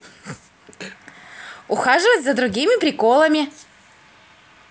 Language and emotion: Russian, positive